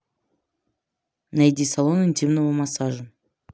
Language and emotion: Russian, neutral